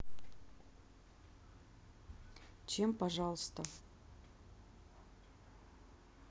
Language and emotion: Russian, neutral